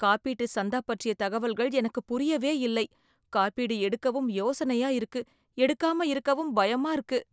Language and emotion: Tamil, fearful